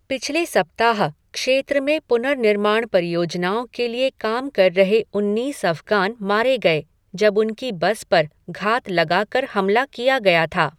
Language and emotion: Hindi, neutral